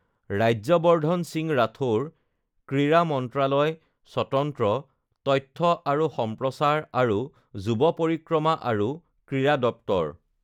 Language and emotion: Assamese, neutral